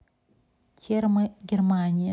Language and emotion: Russian, neutral